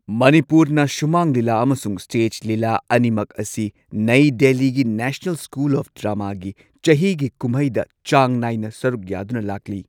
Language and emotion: Manipuri, neutral